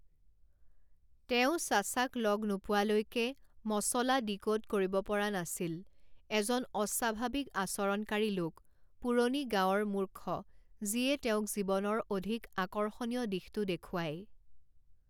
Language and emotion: Assamese, neutral